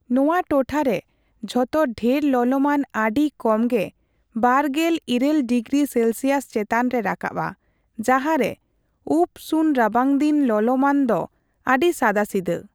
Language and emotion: Santali, neutral